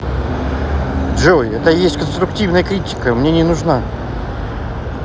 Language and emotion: Russian, neutral